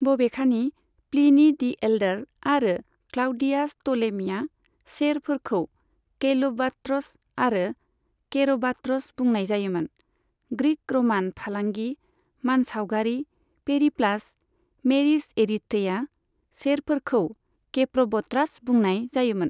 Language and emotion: Bodo, neutral